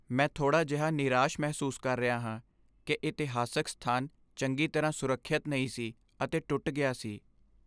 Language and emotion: Punjabi, sad